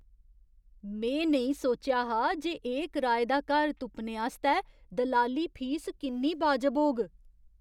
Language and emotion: Dogri, surprised